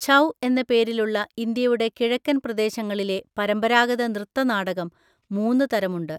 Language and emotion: Malayalam, neutral